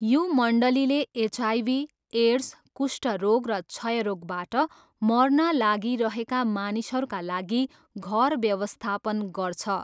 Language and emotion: Nepali, neutral